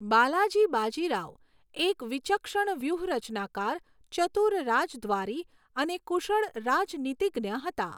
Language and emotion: Gujarati, neutral